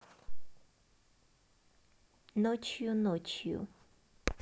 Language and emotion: Russian, neutral